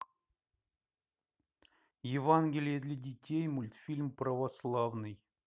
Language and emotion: Russian, neutral